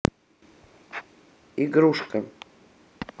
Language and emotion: Russian, neutral